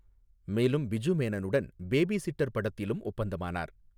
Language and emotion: Tamil, neutral